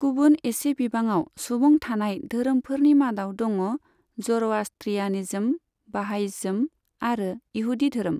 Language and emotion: Bodo, neutral